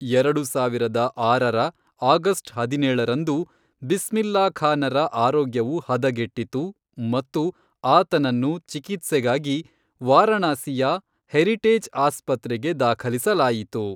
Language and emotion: Kannada, neutral